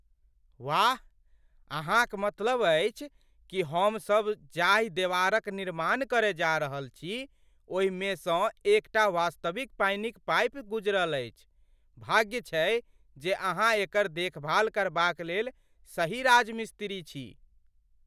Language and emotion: Maithili, surprised